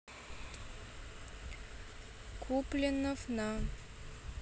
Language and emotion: Russian, neutral